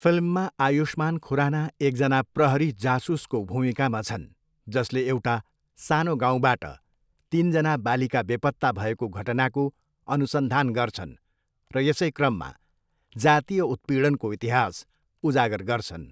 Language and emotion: Nepali, neutral